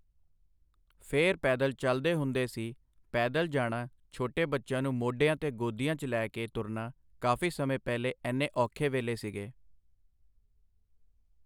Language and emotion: Punjabi, neutral